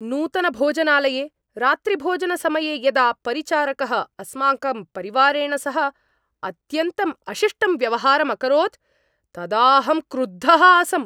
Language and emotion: Sanskrit, angry